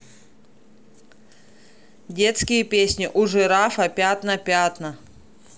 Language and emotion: Russian, neutral